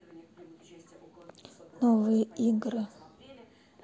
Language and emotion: Russian, sad